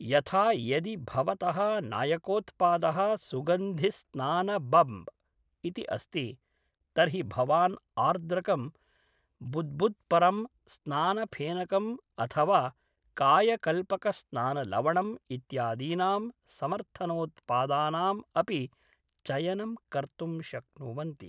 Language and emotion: Sanskrit, neutral